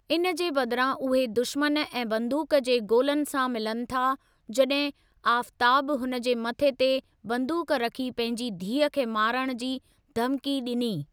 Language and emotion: Sindhi, neutral